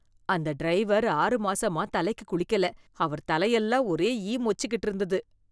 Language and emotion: Tamil, disgusted